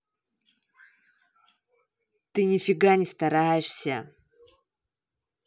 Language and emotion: Russian, angry